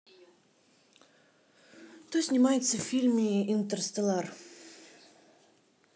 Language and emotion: Russian, neutral